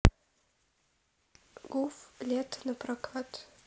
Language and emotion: Russian, sad